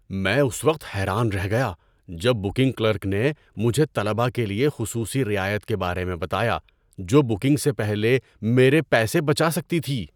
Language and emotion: Urdu, surprised